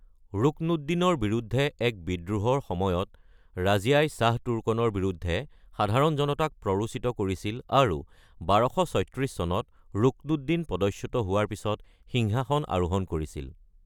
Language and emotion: Assamese, neutral